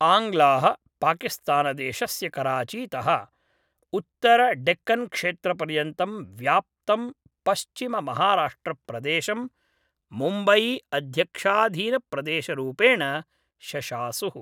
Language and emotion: Sanskrit, neutral